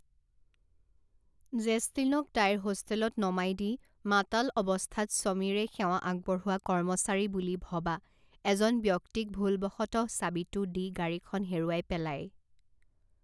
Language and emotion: Assamese, neutral